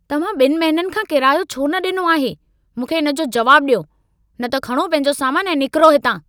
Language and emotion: Sindhi, angry